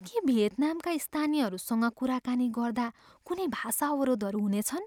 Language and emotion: Nepali, fearful